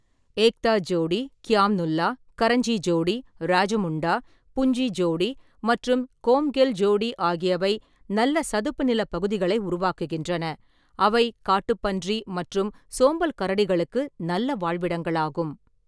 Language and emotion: Tamil, neutral